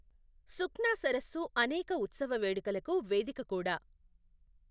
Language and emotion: Telugu, neutral